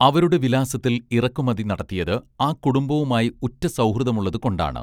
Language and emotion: Malayalam, neutral